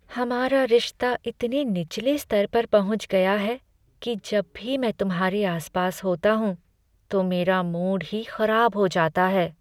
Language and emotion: Hindi, sad